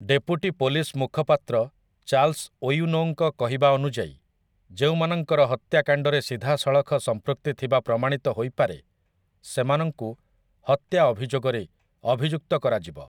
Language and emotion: Odia, neutral